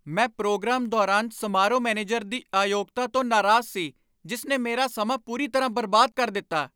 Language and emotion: Punjabi, angry